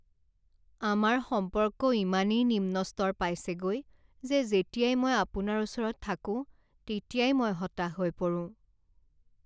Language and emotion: Assamese, sad